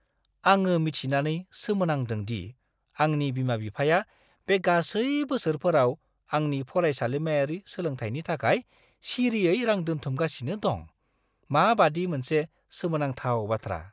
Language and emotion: Bodo, surprised